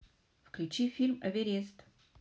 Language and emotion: Russian, neutral